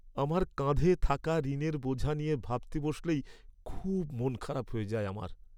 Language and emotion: Bengali, sad